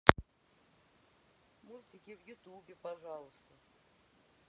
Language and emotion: Russian, neutral